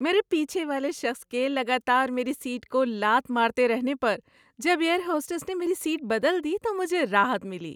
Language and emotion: Urdu, happy